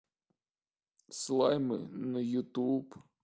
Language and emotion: Russian, sad